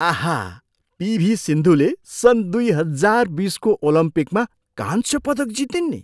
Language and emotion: Nepali, surprised